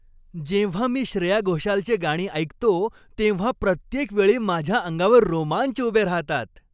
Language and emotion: Marathi, happy